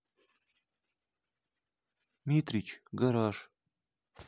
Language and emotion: Russian, sad